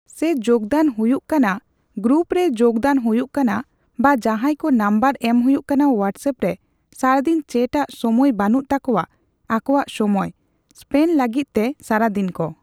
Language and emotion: Santali, neutral